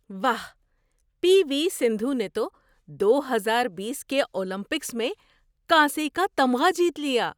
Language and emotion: Urdu, surprised